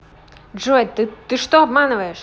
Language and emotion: Russian, angry